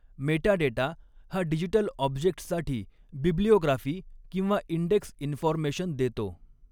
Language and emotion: Marathi, neutral